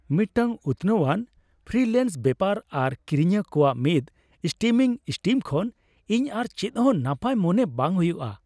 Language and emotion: Santali, happy